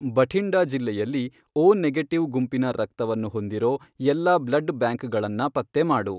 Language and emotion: Kannada, neutral